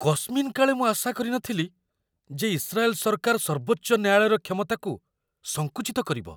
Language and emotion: Odia, surprised